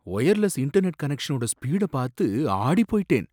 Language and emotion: Tamil, surprised